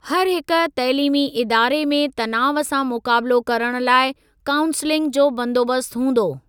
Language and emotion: Sindhi, neutral